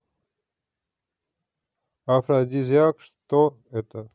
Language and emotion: Russian, neutral